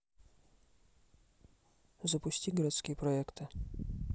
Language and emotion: Russian, neutral